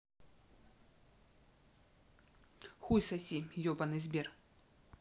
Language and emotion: Russian, angry